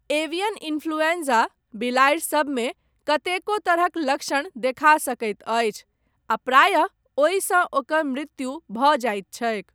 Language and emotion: Maithili, neutral